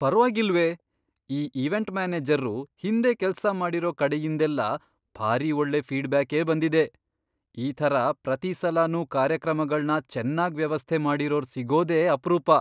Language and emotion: Kannada, surprised